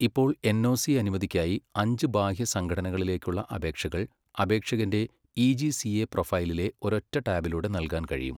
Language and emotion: Malayalam, neutral